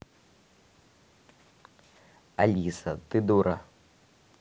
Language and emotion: Russian, neutral